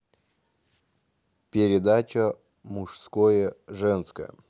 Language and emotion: Russian, neutral